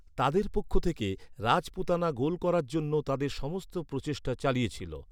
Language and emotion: Bengali, neutral